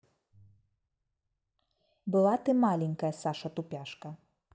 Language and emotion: Russian, neutral